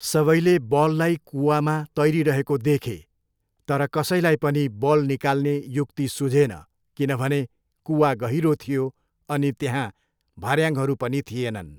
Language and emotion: Nepali, neutral